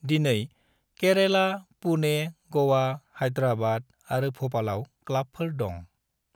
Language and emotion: Bodo, neutral